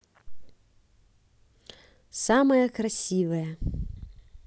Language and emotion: Russian, positive